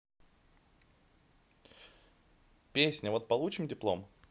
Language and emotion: Russian, neutral